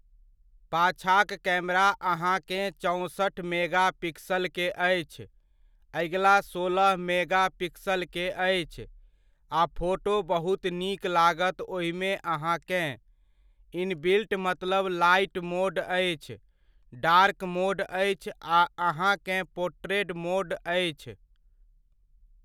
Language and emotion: Maithili, neutral